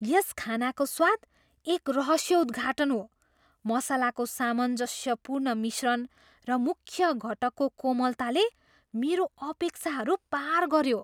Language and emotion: Nepali, surprised